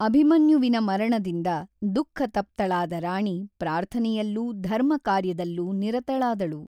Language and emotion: Kannada, neutral